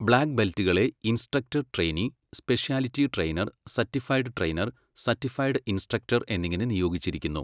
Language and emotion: Malayalam, neutral